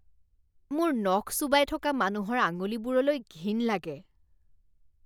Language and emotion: Assamese, disgusted